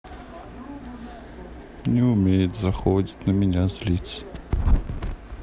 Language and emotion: Russian, sad